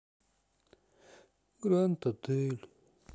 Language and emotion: Russian, sad